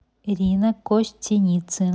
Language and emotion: Russian, neutral